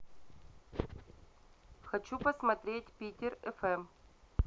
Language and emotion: Russian, neutral